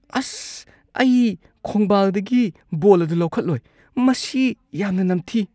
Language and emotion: Manipuri, disgusted